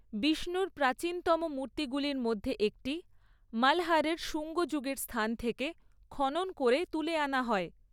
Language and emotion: Bengali, neutral